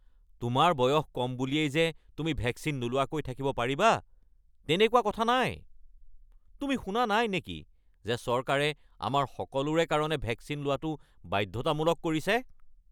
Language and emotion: Assamese, angry